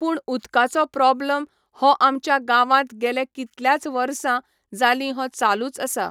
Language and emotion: Goan Konkani, neutral